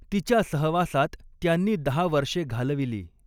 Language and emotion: Marathi, neutral